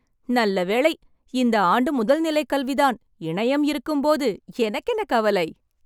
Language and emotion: Tamil, happy